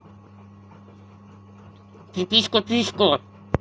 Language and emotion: Russian, angry